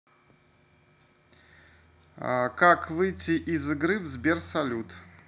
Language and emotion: Russian, neutral